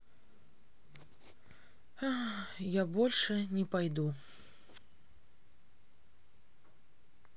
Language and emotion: Russian, sad